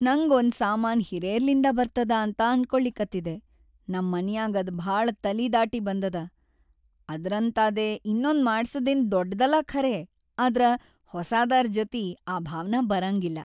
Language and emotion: Kannada, sad